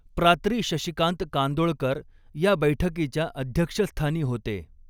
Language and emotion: Marathi, neutral